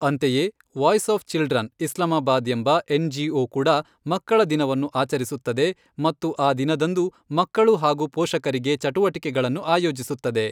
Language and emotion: Kannada, neutral